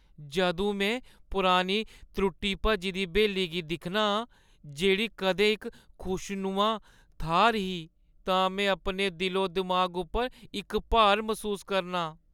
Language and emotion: Dogri, sad